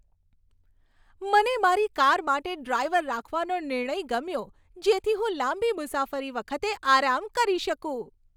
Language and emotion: Gujarati, happy